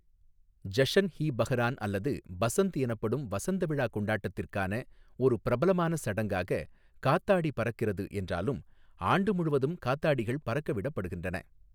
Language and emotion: Tamil, neutral